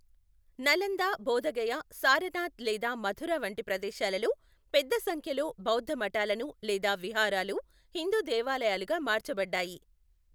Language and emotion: Telugu, neutral